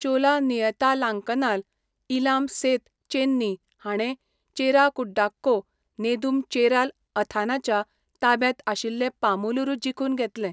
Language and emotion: Goan Konkani, neutral